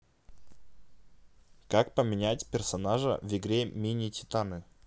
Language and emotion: Russian, neutral